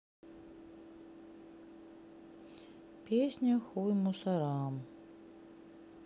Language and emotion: Russian, sad